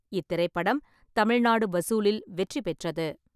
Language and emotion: Tamil, neutral